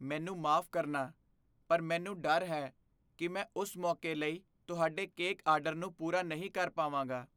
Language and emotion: Punjabi, fearful